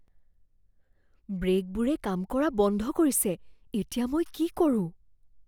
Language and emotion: Assamese, fearful